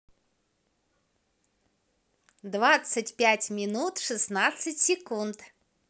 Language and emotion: Russian, positive